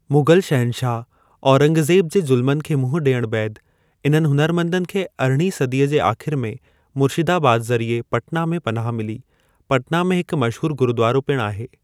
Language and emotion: Sindhi, neutral